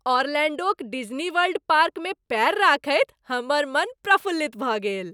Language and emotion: Maithili, happy